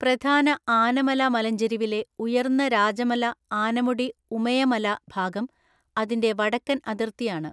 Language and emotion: Malayalam, neutral